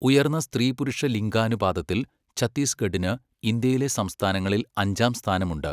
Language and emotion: Malayalam, neutral